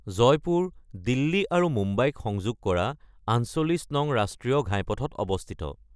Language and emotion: Assamese, neutral